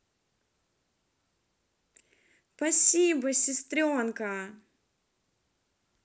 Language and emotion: Russian, positive